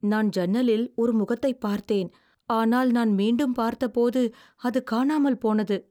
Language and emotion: Tamil, fearful